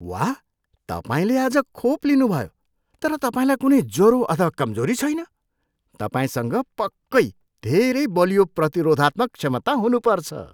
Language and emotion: Nepali, surprised